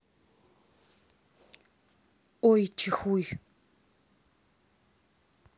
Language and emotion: Russian, neutral